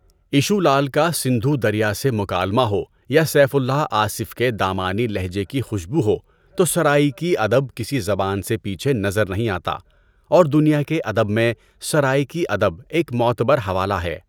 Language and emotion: Urdu, neutral